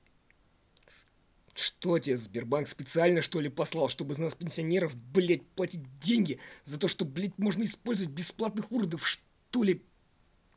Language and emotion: Russian, angry